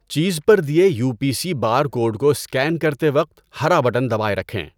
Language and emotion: Urdu, neutral